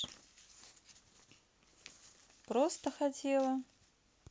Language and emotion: Russian, neutral